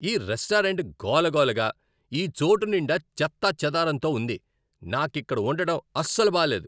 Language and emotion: Telugu, angry